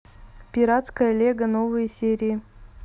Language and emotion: Russian, neutral